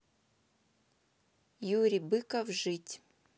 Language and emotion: Russian, neutral